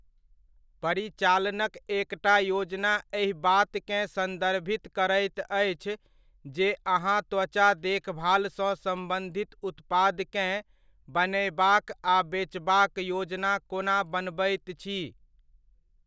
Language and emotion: Maithili, neutral